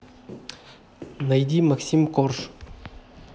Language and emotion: Russian, neutral